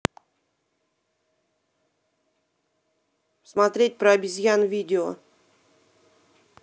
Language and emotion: Russian, angry